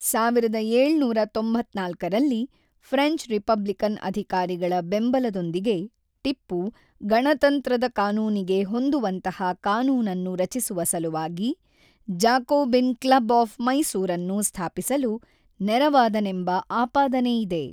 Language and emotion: Kannada, neutral